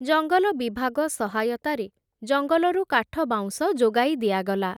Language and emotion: Odia, neutral